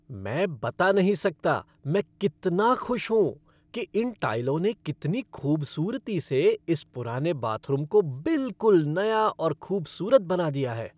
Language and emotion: Hindi, happy